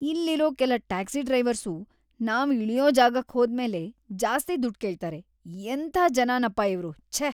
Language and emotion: Kannada, disgusted